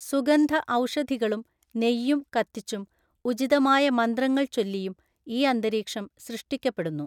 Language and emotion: Malayalam, neutral